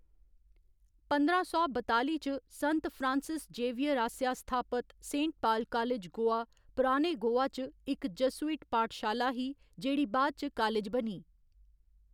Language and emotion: Dogri, neutral